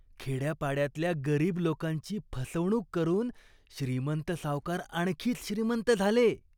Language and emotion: Marathi, disgusted